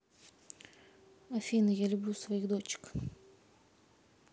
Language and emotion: Russian, neutral